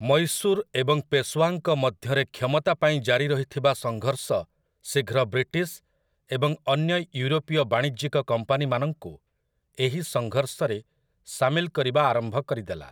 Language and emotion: Odia, neutral